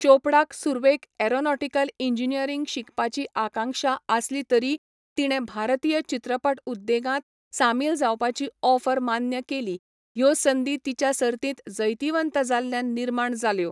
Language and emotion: Goan Konkani, neutral